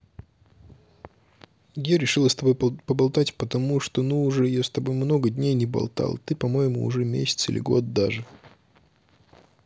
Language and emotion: Russian, neutral